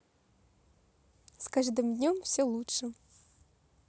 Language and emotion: Russian, positive